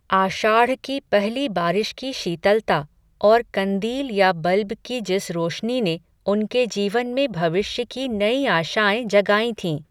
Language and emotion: Hindi, neutral